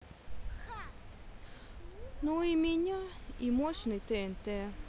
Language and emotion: Russian, sad